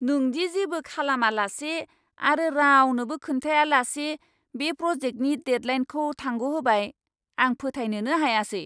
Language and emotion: Bodo, angry